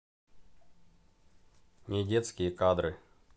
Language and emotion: Russian, neutral